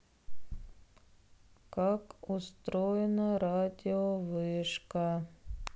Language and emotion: Russian, sad